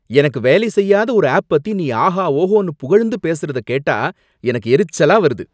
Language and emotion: Tamil, angry